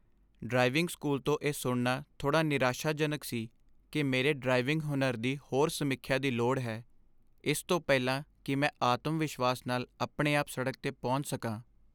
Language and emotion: Punjabi, sad